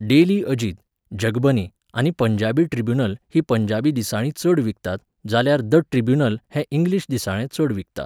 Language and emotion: Goan Konkani, neutral